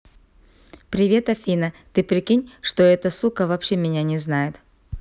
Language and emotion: Russian, neutral